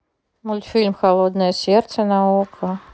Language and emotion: Russian, neutral